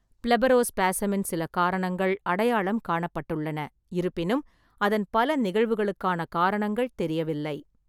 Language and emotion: Tamil, neutral